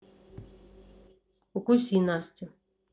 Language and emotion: Russian, neutral